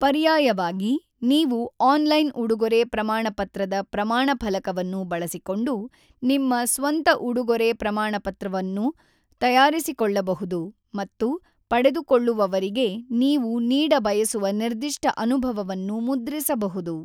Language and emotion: Kannada, neutral